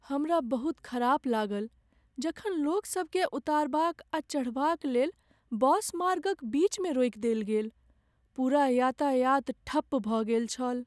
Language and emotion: Maithili, sad